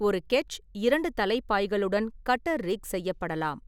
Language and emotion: Tamil, neutral